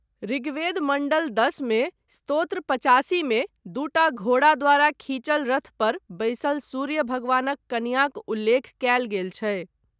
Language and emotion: Maithili, neutral